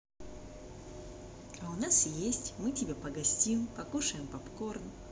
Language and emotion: Russian, positive